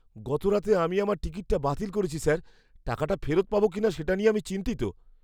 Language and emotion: Bengali, fearful